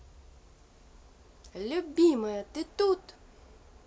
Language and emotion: Russian, positive